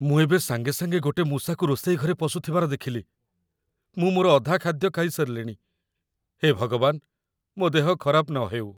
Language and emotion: Odia, fearful